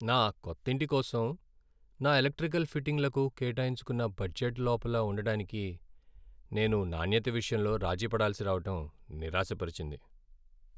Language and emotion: Telugu, sad